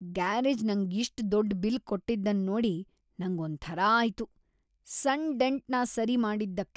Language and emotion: Kannada, disgusted